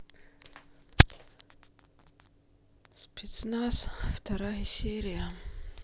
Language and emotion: Russian, sad